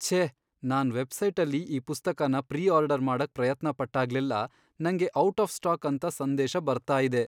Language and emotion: Kannada, sad